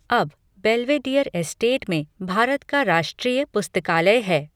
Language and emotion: Hindi, neutral